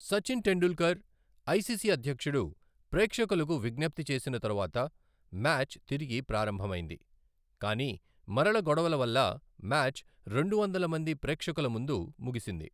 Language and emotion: Telugu, neutral